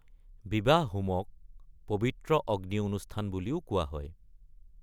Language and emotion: Assamese, neutral